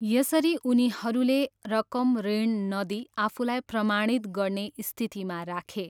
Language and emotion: Nepali, neutral